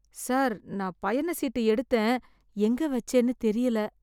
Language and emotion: Tamil, fearful